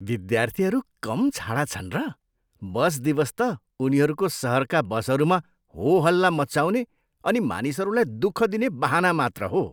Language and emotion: Nepali, disgusted